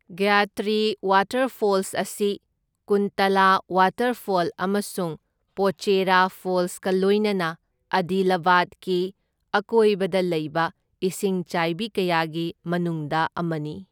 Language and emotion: Manipuri, neutral